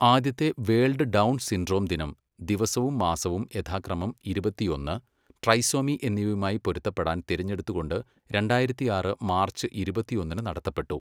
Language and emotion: Malayalam, neutral